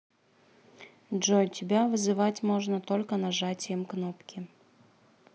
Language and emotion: Russian, neutral